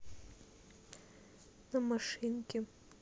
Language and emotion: Russian, neutral